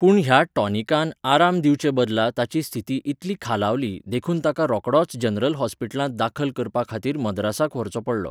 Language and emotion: Goan Konkani, neutral